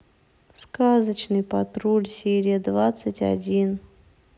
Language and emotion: Russian, sad